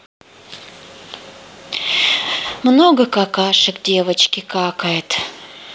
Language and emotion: Russian, sad